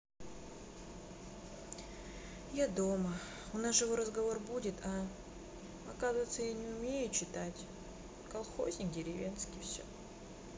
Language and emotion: Russian, sad